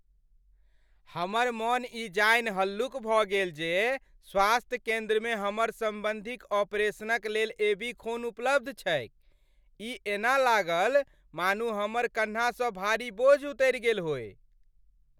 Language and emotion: Maithili, happy